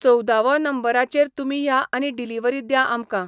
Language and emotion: Goan Konkani, neutral